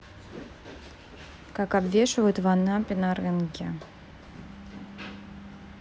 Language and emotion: Russian, neutral